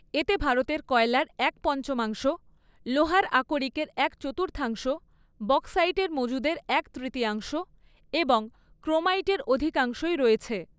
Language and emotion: Bengali, neutral